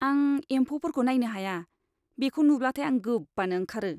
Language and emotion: Bodo, disgusted